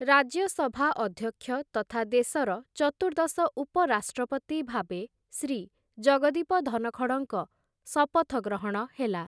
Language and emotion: Odia, neutral